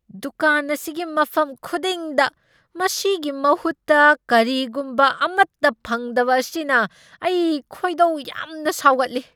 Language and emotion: Manipuri, angry